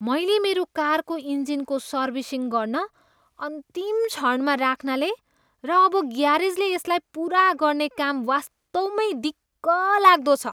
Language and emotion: Nepali, disgusted